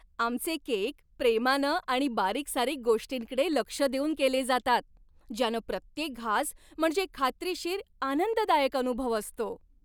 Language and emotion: Marathi, happy